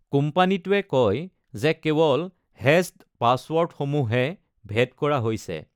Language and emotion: Assamese, neutral